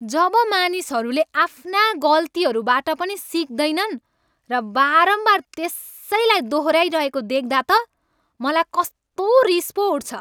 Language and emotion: Nepali, angry